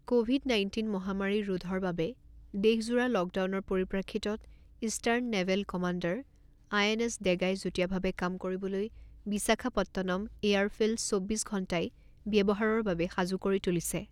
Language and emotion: Assamese, neutral